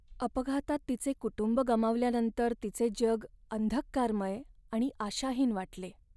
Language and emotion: Marathi, sad